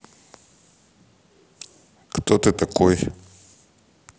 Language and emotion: Russian, neutral